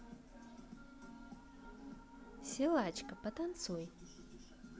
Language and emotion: Russian, neutral